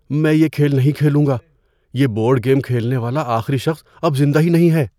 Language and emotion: Urdu, fearful